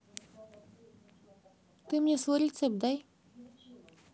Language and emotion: Russian, neutral